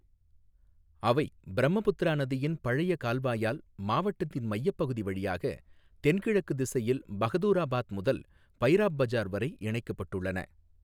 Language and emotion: Tamil, neutral